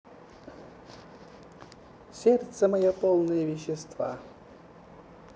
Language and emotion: Russian, neutral